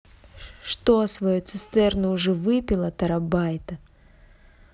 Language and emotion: Russian, angry